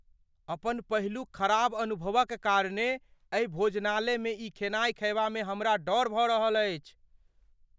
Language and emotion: Maithili, fearful